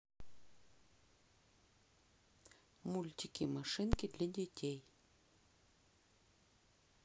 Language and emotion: Russian, neutral